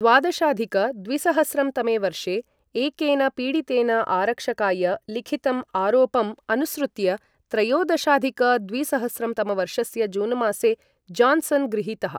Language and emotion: Sanskrit, neutral